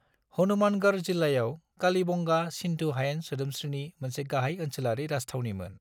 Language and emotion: Bodo, neutral